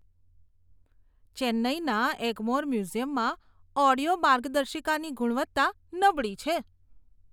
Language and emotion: Gujarati, disgusted